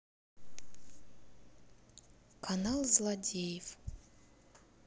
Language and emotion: Russian, neutral